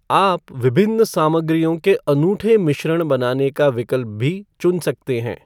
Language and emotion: Hindi, neutral